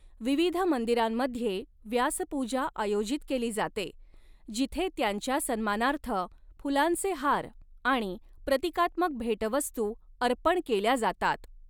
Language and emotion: Marathi, neutral